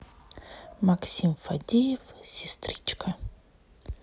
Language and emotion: Russian, neutral